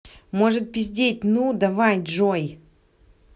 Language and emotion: Russian, angry